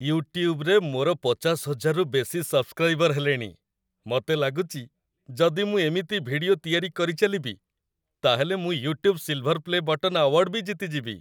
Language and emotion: Odia, happy